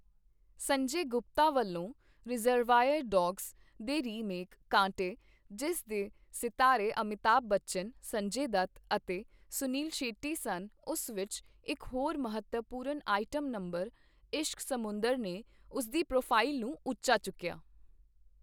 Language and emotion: Punjabi, neutral